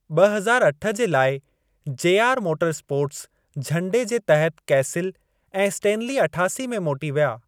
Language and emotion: Sindhi, neutral